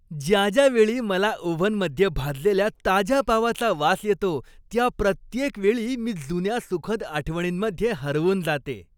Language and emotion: Marathi, happy